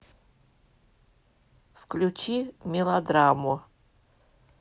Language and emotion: Russian, neutral